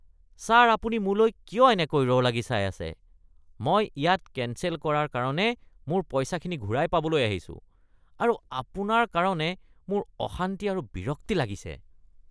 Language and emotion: Assamese, disgusted